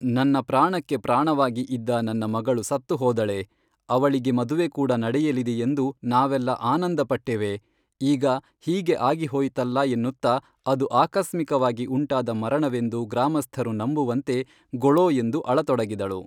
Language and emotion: Kannada, neutral